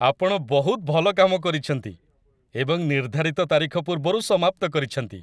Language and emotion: Odia, happy